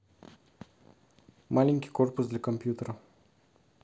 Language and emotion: Russian, neutral